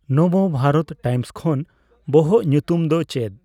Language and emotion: Santali, neutral